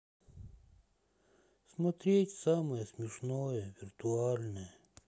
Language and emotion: Russian, sad